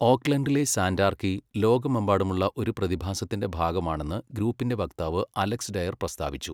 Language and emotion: Malayalam, neutral